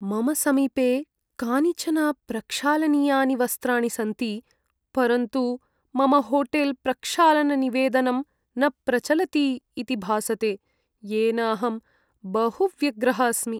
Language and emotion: Sanskrit, sad